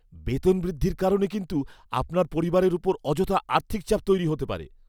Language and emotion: Bengali, fearful